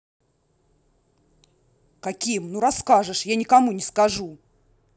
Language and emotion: Russian, angry